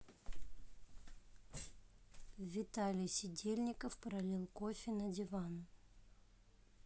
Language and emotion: Russian, neutral